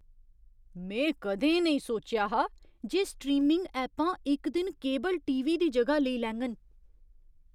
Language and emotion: Dogri, surprised